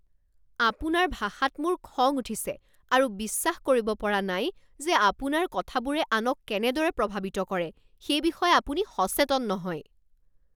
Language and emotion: Assamese, angry